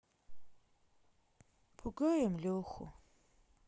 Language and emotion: Russian, sad